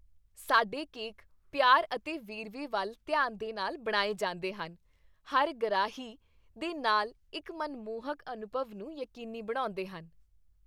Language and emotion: Punjabi, happy